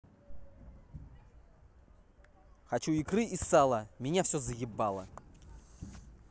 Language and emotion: Russian, angry